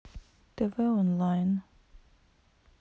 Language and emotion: Russian, neutral